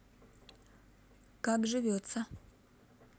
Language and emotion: Russian, neutral